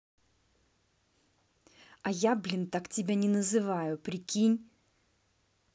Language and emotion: Russian, angry